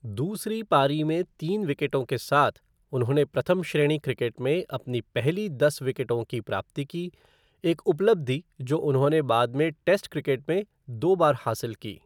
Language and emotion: Hindi, neutral